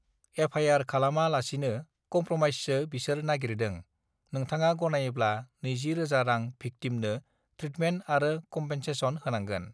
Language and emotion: Bodo, neutral